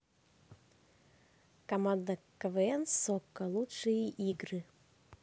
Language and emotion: Russian, neutral